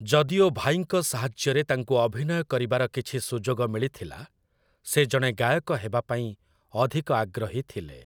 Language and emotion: Odia, neutral